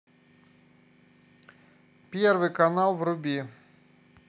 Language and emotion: Russian, neutral